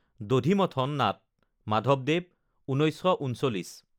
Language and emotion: Assamese, neutral